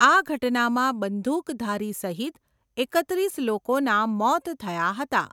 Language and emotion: Gujarati, neutral